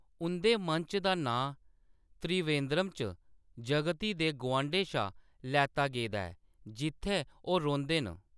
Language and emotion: Dogri, neutral